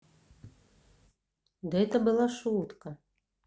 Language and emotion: Russian, neutral